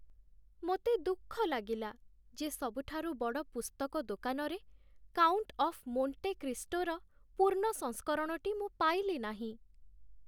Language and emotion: Odia, sad